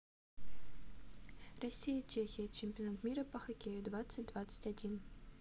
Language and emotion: Russian, neutral